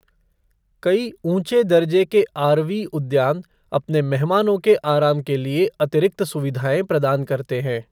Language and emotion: Hindi, neutral